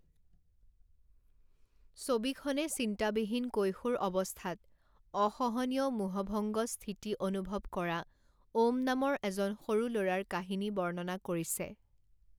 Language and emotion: Assamese, neutral